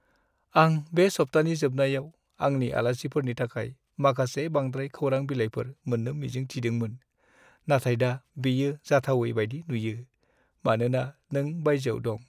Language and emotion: Bodo, sad